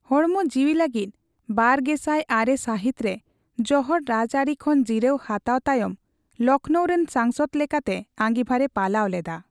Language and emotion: Santali, neutral